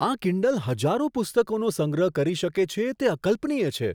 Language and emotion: Gujarati, surprised